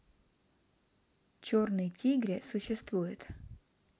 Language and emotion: Russian, neutral